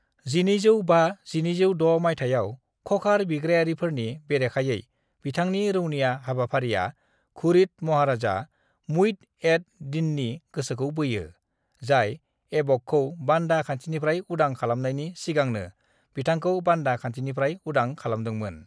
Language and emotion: Bodo, neutral